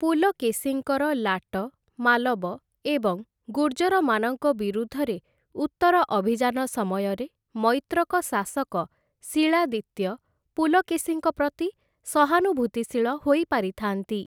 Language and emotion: Odia, neutral